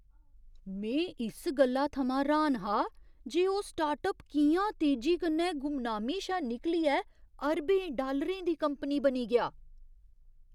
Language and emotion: Dogri, surprised